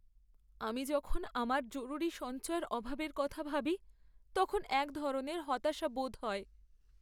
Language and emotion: Bengali, sad